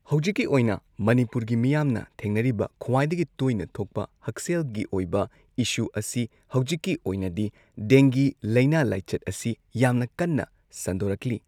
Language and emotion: Manipuri, neutral